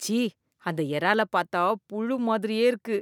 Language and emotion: Tamil, disgusted